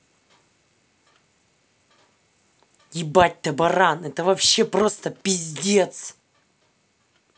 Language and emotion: Russian, angry